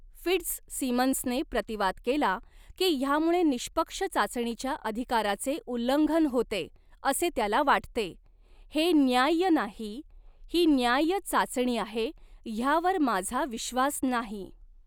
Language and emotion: Marathi, neutral